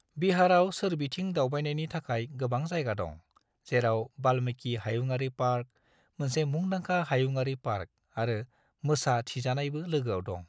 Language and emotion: Bodo, neutral